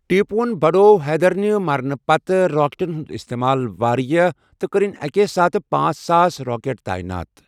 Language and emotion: Kashmiri, neutral